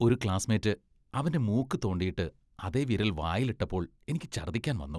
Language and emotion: Malayalam, disgusted